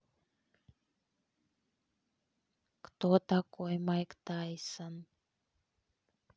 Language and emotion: Russian, neutral